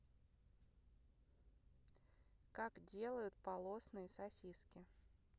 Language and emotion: Russian, neutral